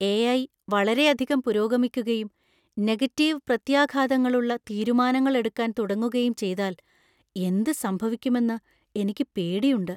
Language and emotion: Malayalam, fearful